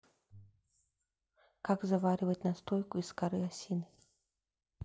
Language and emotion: Russian, neutral